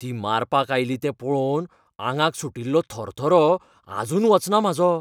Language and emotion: Goan Konkani, fearful